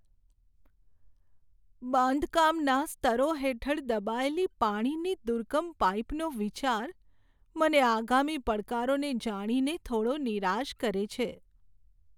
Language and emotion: Gujarati, sad